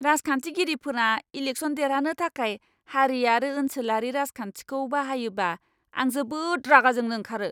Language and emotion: Bodo, angry